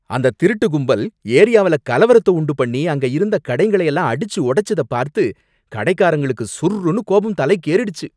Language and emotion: Tamil, angry